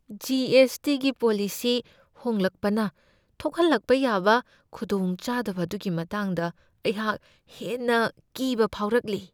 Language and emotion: Manipuri, fearful